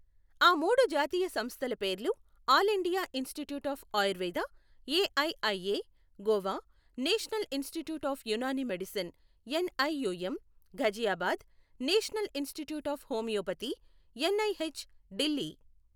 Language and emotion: Telugu, neutral